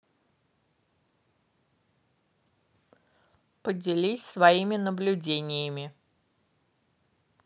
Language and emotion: Russian, neutral